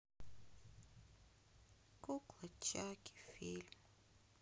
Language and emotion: Russian, sad